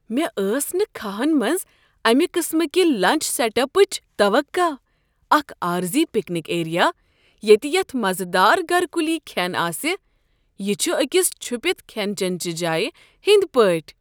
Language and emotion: Kashmiri, surprised